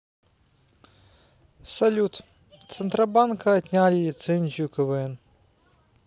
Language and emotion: Russian, neutral